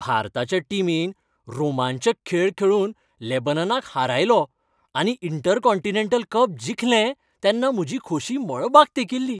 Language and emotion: Goan Konkani, happy